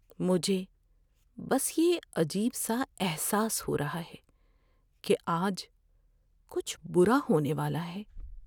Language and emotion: Urdu, fearful